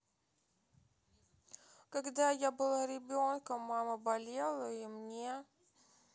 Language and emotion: Russian, sad